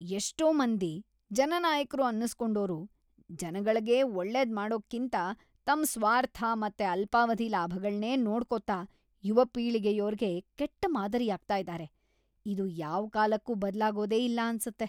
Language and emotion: Kannada, disgusted